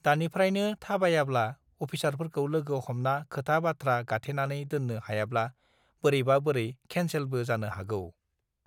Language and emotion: Bodo, neutral